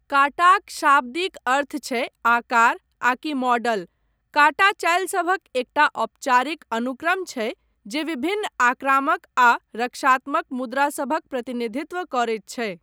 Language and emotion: Maithili, neutral